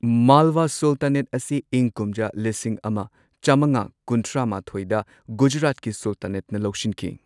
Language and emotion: Manipuri, neutral